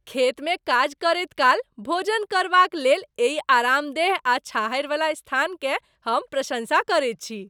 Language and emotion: Maithili, happy